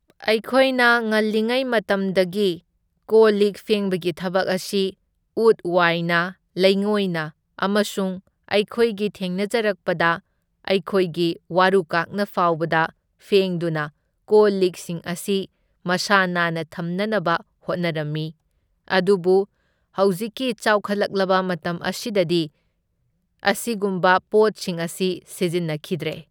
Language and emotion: Manipuri, neutral